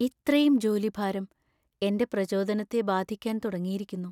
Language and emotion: Malayalam, sad